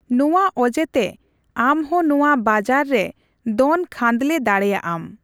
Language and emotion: Santali, neutral